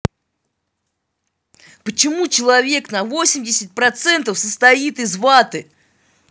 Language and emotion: Russian, angry